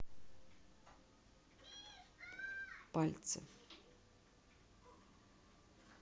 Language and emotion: Russian, neutral